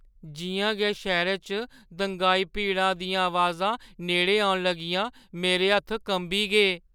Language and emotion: Dogri, fearful